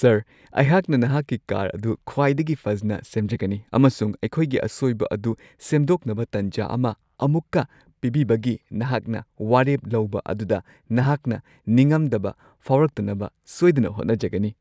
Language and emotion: Manipuri, happy